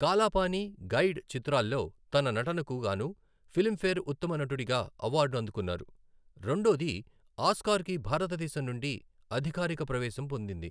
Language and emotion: Telugu, neutral